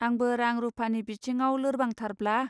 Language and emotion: Bodo, neutral